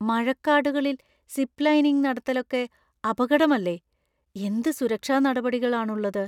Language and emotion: Malayalam, fearful